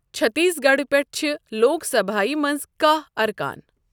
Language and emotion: Kashmiri, neutral